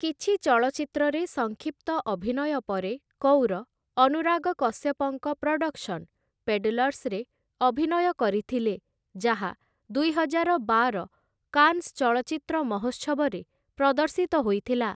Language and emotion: Odia, neutral